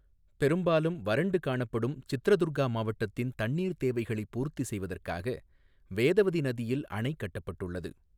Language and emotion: Tamil, neutral